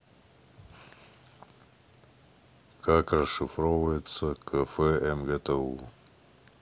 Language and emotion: Russian, neutral